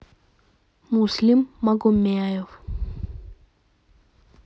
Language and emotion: Russian, neutral